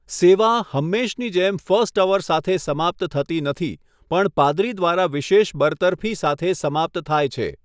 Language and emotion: Gujarati, neutral